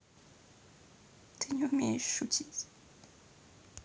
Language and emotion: Russian, sad